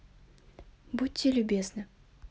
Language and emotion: Russian, neutral